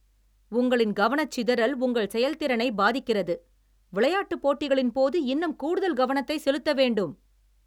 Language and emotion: Tamil, angry